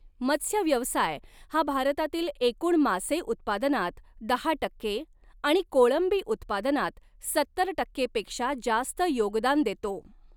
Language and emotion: Marathi, neutral